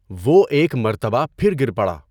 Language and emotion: Urdu, neutral